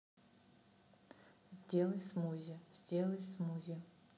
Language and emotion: Russian, neutral